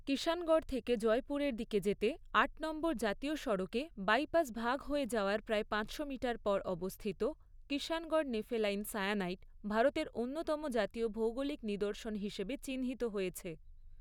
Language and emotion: Bengali, neutral